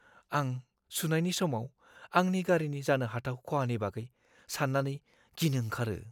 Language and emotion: Bodo, fearful